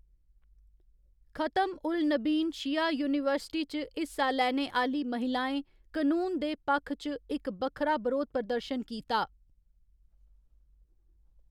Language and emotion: Dogri, neutral